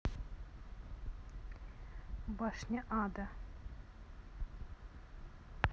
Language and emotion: Russian, neutral